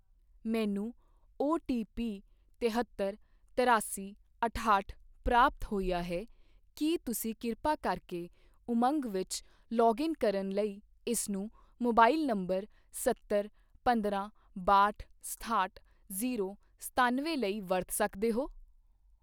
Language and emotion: Punjabi, neutral